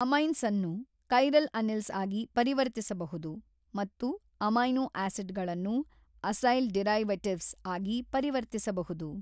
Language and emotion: Kannada, neutral